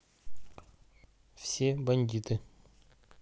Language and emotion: Russian, neutral